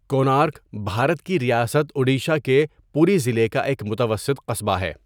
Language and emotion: Urdu, neutral